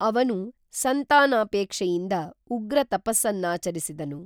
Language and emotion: Kannada, neutral